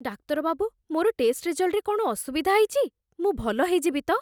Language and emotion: Odia, fearful